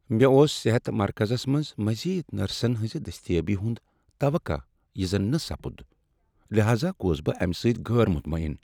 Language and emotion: Kashmiri, sad